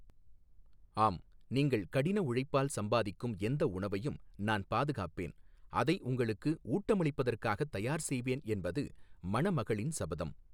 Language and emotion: Tamil, neutral